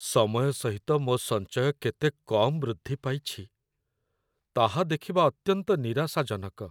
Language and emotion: Odia, sad